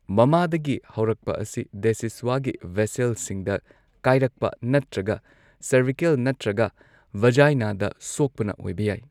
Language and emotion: Manipuri, neutral